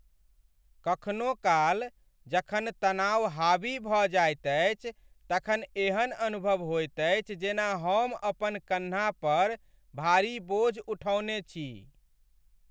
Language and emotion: Maithili, sad